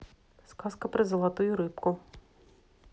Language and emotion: Russian, neutral